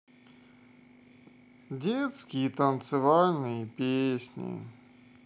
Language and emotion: Russian, sad